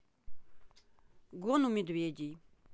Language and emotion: Russian, neutral